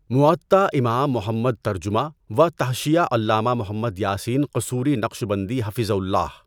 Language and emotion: Urdu, neutral